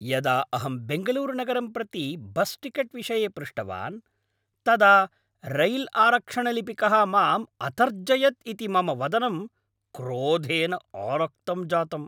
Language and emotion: Sanskrit, angry